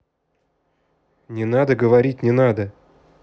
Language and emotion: Russian, angry